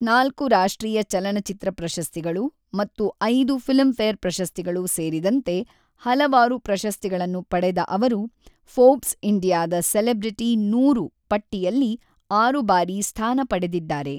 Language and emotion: Kannada, neutral